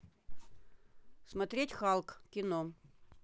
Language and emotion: Russian, neutral